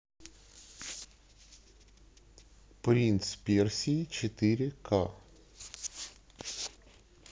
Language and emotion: Russian, neutral